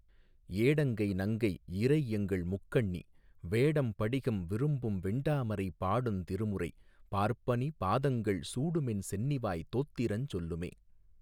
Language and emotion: Tamil, neutral